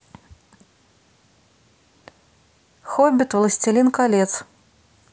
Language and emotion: Russian, neutral